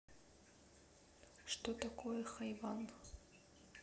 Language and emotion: Russian, neutral